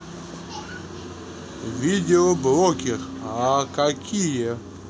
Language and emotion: Russian, neutral